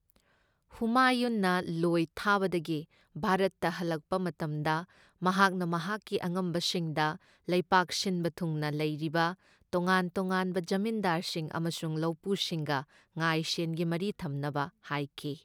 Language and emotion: Manipuri, neutral